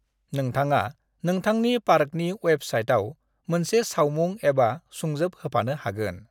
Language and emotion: Bodo, neutral